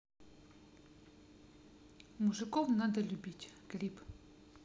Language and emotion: Russian, neutral